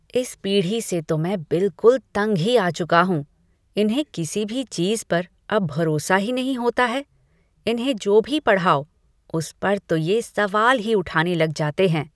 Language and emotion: Hindi, disgusted